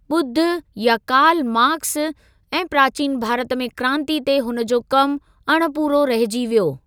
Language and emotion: Sindhi, neutral